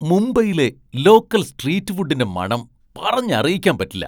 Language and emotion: Malayalam, surprised